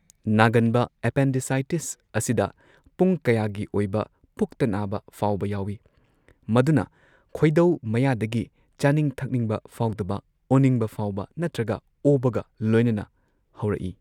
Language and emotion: Manipuri, neutral